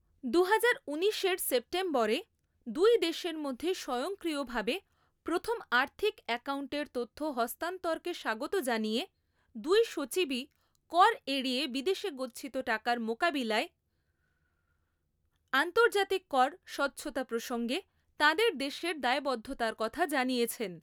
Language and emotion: Bengali, neutral